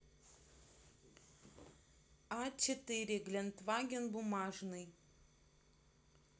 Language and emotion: Russian, neutral